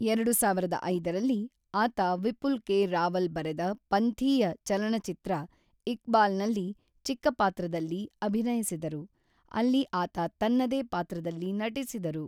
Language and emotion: Kannada, neutral